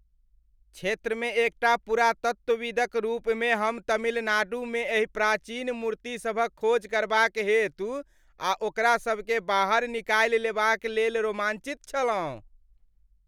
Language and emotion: Maithili, happy